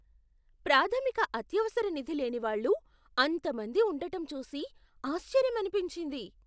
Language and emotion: Telugu, surprised